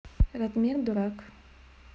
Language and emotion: Russian, neutral